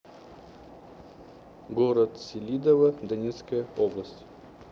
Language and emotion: Russian, neutral